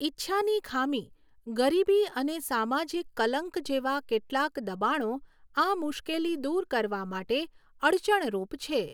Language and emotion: Gujarati, neutral